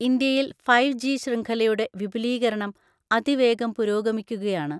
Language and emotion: Malayalam, neutral